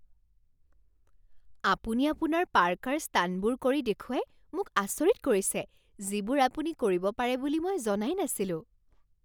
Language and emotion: Assamese, surprised